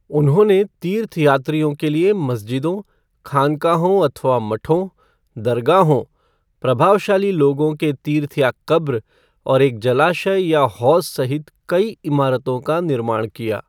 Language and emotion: Hindi, neutral